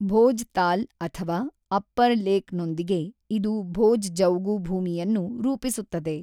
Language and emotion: Kannada, neutral